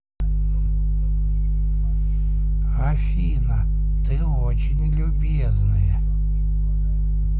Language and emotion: Russian, positive